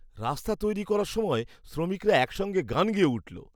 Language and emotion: Bengali, happy